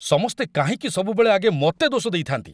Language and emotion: Odia, angry